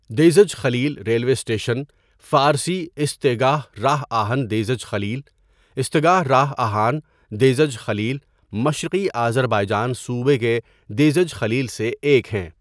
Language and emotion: Urdu, neutral